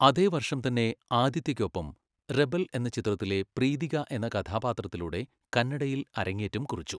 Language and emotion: Malayalam, neutral